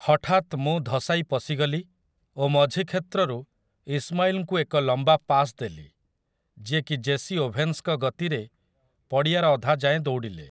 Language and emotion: Odia, neutral